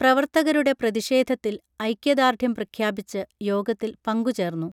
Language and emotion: Malayalam, neutral